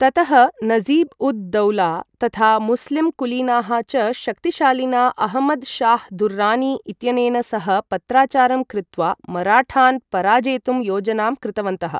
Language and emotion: Sanskrit, neutral